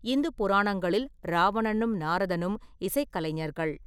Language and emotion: Tamil, neutral